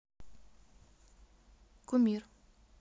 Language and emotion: Russian, neutral